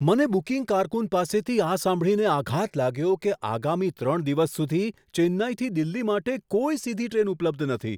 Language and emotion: Gujarati, surprised